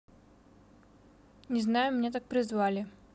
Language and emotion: Russian, neutral